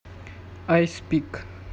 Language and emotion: Russian, neutral